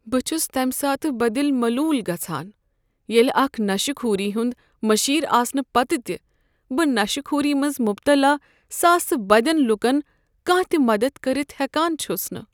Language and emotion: Kashmiri, sad